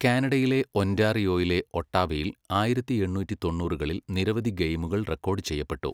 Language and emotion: Malayalam, neutral